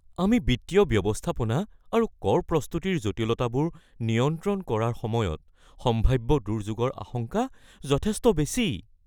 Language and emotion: Assamese, fearful